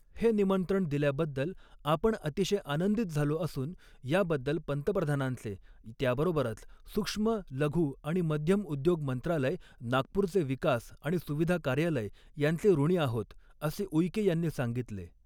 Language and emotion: Marathi, neutral